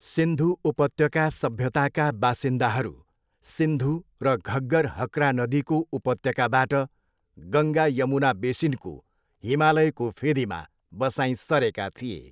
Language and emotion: Nepali, neutral